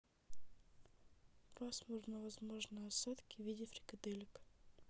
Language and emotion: Russian, neutral